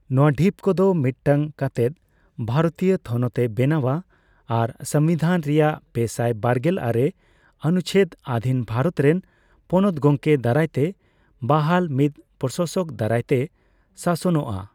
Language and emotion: Santali, neutral